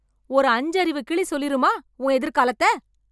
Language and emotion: Tamil, angry